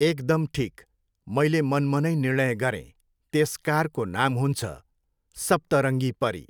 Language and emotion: Nepali, neutral